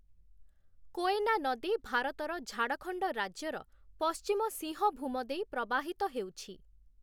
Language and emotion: Odia, neutral